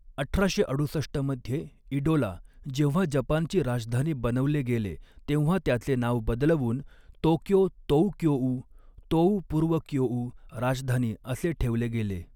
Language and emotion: Marathi, neutral